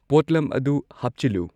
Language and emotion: Manipuri, neutral